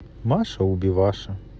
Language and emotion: Russian, neutral